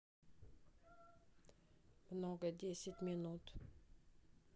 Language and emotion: Russian, neutral